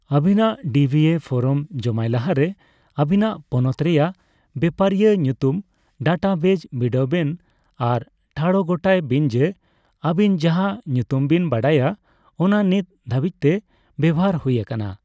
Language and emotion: Santali, neutral